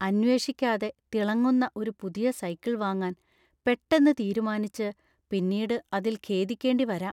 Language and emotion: Malayalam, fearful